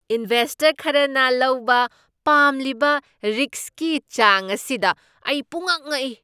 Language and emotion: Manipuri, surprised